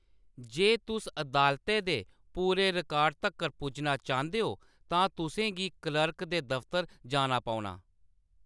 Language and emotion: Dogri, neutral